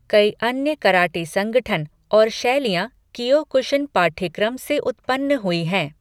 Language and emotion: Hindi, neutral